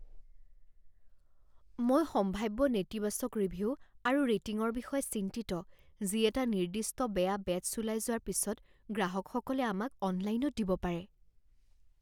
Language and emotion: Assamese, fearful